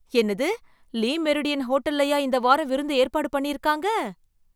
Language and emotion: Tamil, surprised